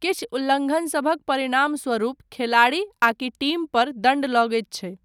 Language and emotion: Maithili, neutral